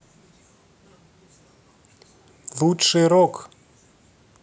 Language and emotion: Russian, neutral